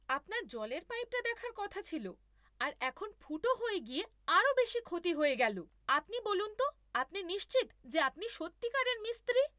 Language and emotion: Bengali, angry